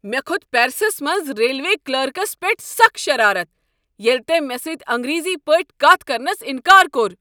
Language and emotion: Kashmiri, angry